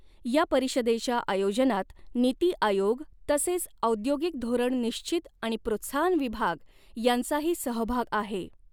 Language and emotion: Marathi, neutral